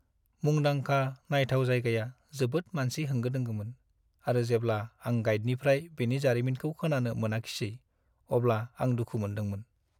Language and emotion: Bodo, sad